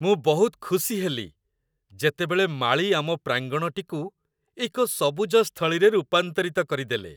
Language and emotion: Odia, happy